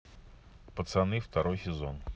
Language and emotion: Russian, neutral